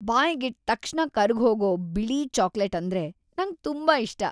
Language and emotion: Kannada, happy